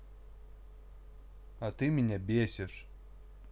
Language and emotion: Russian, neutral